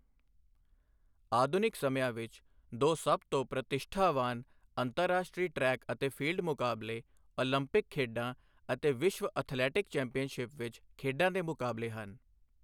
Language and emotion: Punjabi, neutral